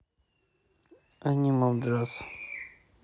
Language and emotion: Russian, neutral